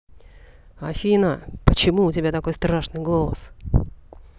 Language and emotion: Russian, angry